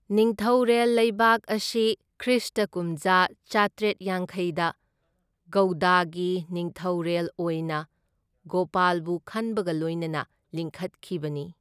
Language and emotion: Manipuri, neutral